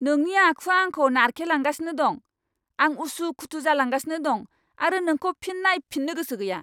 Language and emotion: Bodo, angry